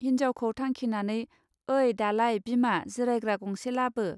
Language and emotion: Bodo, neutral